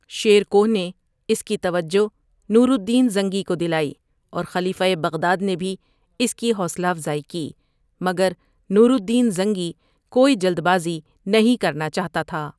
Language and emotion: Urdu, neutral